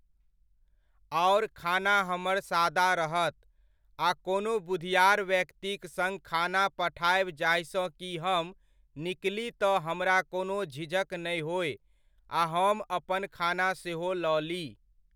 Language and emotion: Maithili, neutral